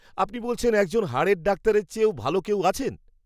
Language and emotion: Bengali, surprised